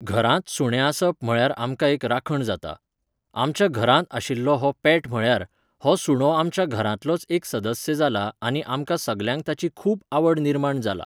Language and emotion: Goan Konkani, neutral